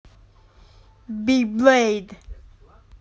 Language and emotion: Russian, neutral